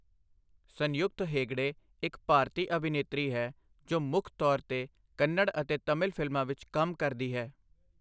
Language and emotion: Punjabi, neutral